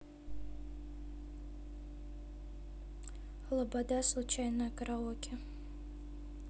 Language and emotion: Russian, neutral